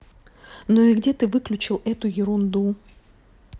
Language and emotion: Russian, angry